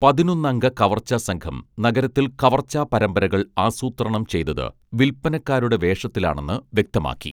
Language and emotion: Malayalam, neutral